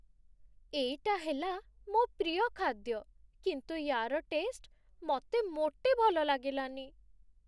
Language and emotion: Odia, sad